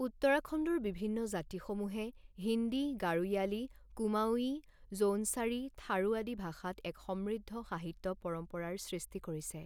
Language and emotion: Assamese, neutral